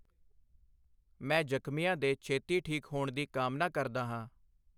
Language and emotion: Punjabi, neutral